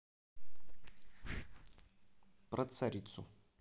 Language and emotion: Russian, neutral